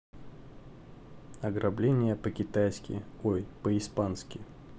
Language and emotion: Russian, neutral